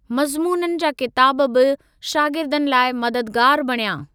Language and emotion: Sindhi, neutral